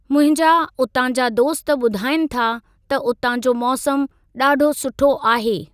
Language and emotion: Sindhi, neutral